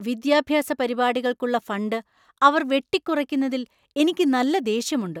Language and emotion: Malayalam, angry